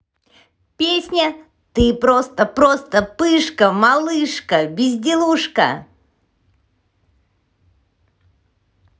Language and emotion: Russian, positive